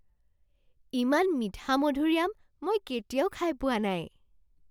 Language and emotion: Assamese, surprised